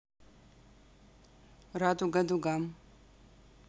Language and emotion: Russian, neutral